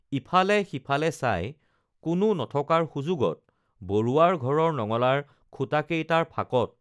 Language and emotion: Assamese, neutral